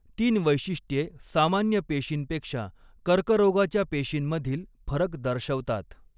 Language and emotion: Marathi, neutral